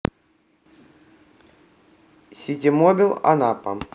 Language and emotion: Russian, neutral